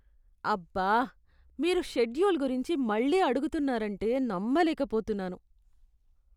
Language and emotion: Telugu, disgusted